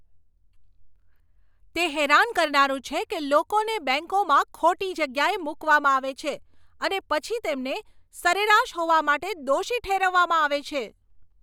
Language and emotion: Gujarati, angry